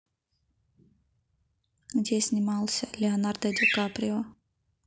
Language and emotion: Russian, neutral